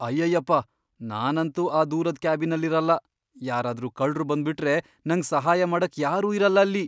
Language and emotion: Kannada, fearful